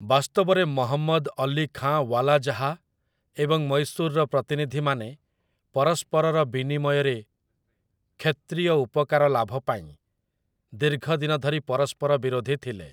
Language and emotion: Odia, neutral